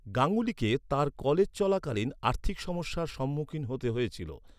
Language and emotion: Bengali, neutral